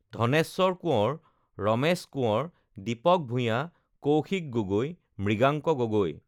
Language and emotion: Assamese, neutral